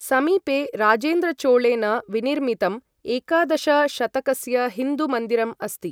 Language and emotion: Sanskrit, neutral